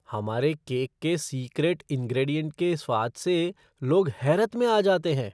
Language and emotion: Hindi, surprised